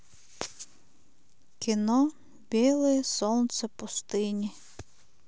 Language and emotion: Russian, sad